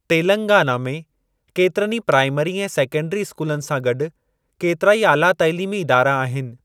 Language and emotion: Sindhi, neutral